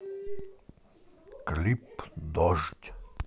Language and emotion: Russian, neutral